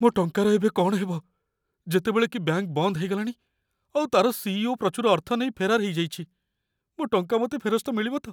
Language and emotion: Odia, fearful